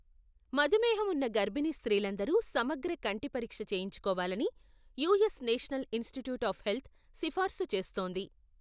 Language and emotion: Telugu, neutral